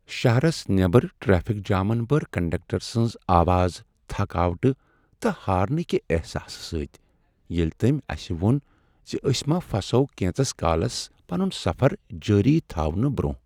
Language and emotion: Kashmiri, sad